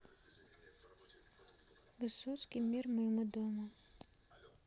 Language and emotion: Russian, sad